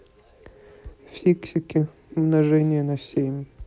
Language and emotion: Russian, neutral